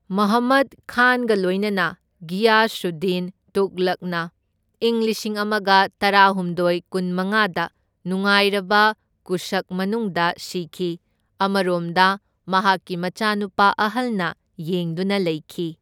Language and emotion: Manipuri, neutral